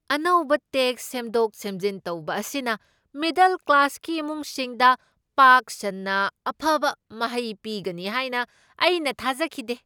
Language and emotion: Manipuri, surprised